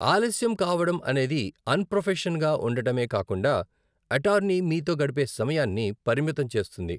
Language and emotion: Telugu, neutral